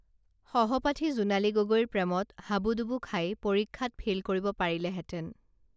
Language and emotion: Assamese, neutral